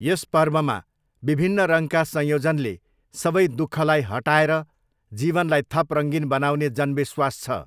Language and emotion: Nepali, neutral